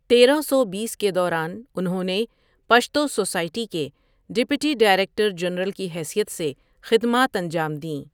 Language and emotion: Urdu, neutral